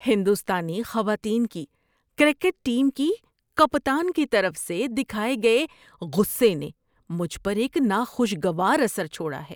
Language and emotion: Urdu, disgusted